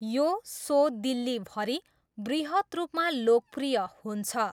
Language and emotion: Nepali, neutral